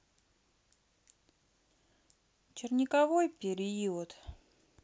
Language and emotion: Russian, sad